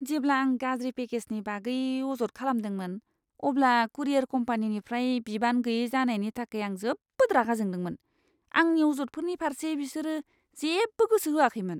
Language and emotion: Bodo, disgusted